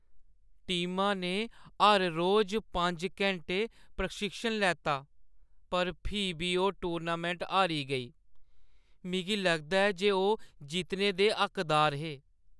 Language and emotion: Dogri, sad